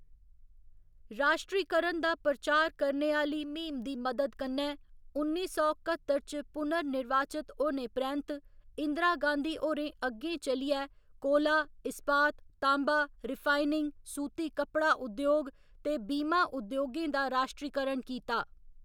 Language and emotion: Dogri, neutral